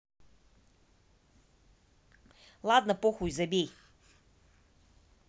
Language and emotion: Russian, neutral